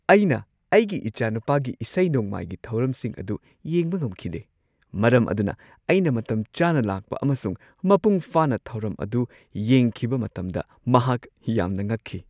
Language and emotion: Manipuri, surprised